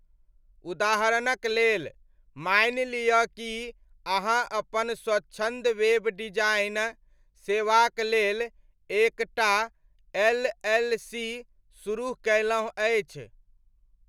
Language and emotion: Maithili, neutral